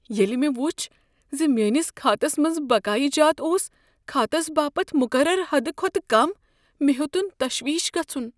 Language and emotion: Kashmiri, fearful